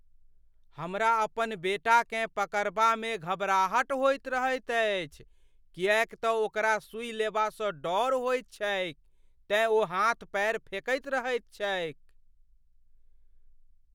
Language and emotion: Maithili, fearful